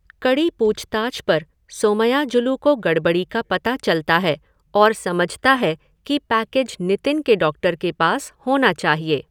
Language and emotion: Hindi, neutral